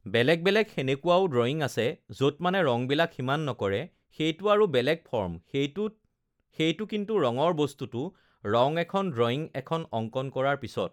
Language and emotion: Assamese, neutral